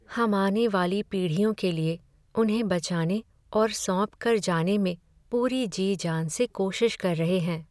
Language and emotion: Hindi, sad